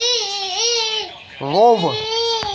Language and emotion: Russian, neutral